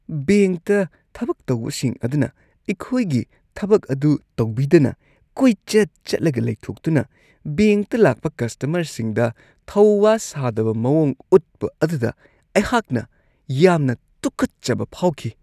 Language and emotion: Manipuri, disgusted